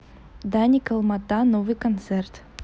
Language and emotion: Russian, neutral